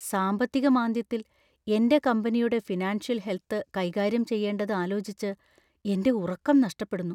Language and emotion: Malayalam, fearful